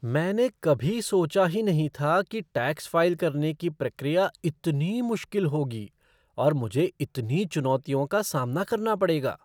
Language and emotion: Hindi, surprised